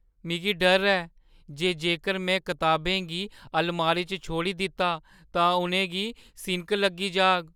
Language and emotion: Dogri, fearful